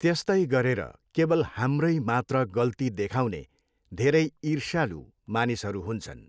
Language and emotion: Nepali, neutral